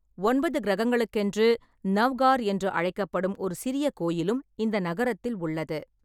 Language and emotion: Tamil, neutral